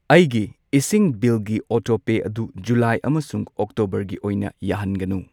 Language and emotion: Manipuri, neutral